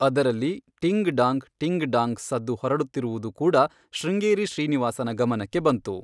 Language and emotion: Kannada, neutral